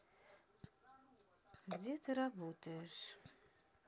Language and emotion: Russian, neutral